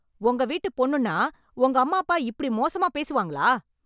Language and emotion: Tamil, angry